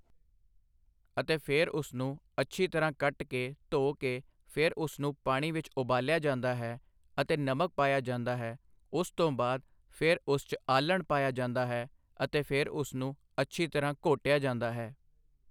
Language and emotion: Punjabi, neutral